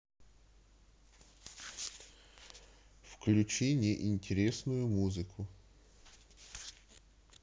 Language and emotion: Russian, neutral